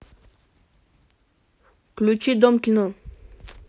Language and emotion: Russian, neutral